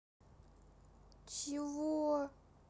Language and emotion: Russian, neutral